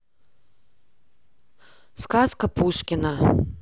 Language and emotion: Russian, neutral